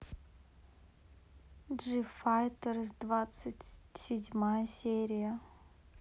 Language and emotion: Russian, neutral